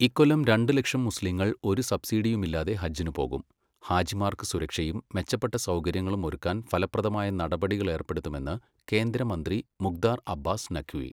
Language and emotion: Malayalam, neutral